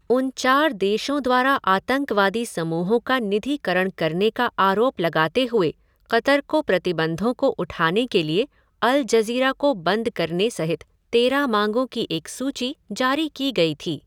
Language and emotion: Hindi, neutral